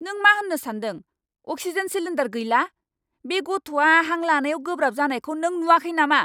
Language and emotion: Bodo, angry